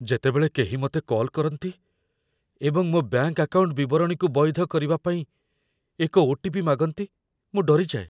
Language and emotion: Odia, fearful